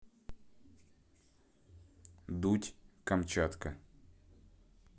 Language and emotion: Russian, neutral